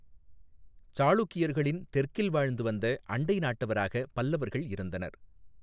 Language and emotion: Tamil, neutral